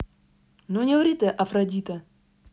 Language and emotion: Russian, neutral